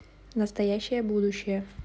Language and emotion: Russian, neutral